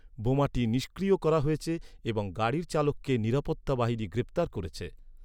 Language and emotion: Bengali, neutral